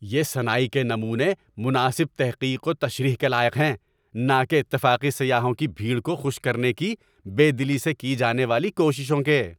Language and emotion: Urdu, angry